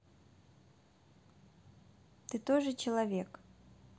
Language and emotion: Russian, neutral